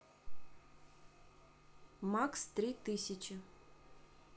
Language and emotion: Russian, neutral